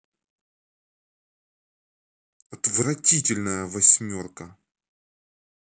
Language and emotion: Russian, angry